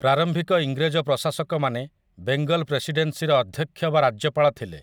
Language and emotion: Odia, neutral